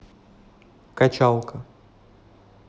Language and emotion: Russian, neutral